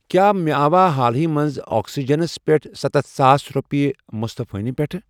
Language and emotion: Kashmiri, neutral